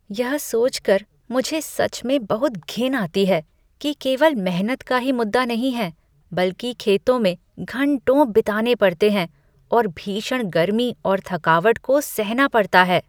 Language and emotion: Hindi, disgusted